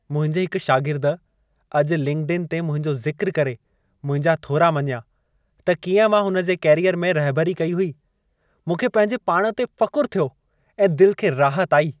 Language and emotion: Sindhi, happy